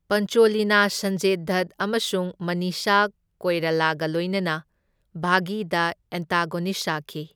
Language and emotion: Manipuri, neutral